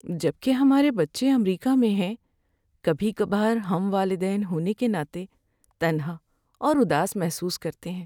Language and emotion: Urdu, sad